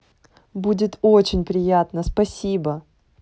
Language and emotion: Russian, positive